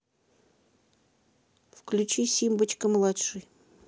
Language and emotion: Russian, neutral